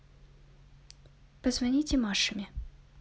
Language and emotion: Russian, neutral